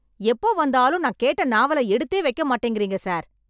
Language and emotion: Tamil, angry